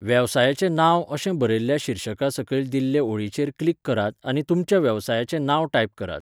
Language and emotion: Goan Konkani, neutral